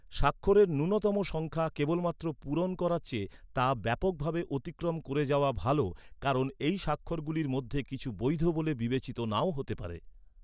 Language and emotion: Bengali, neutral